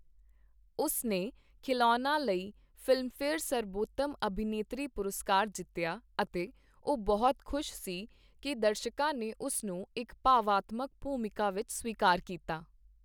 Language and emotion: Punjabi, neutral